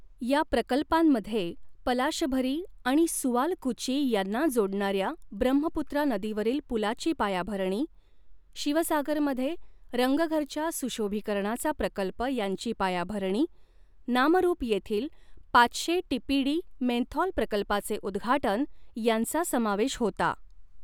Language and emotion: Marathi, neutral